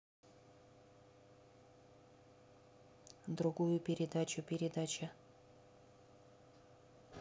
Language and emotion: Russian, neutral